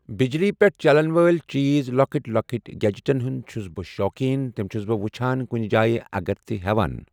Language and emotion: Kashmiri, neutral